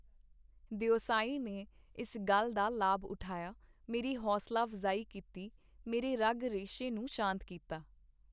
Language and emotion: Punjabi, neutral